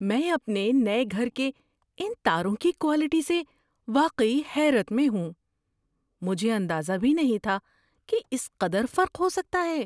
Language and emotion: Urdu, surprised